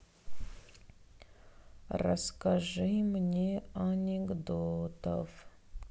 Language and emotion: Russian, sad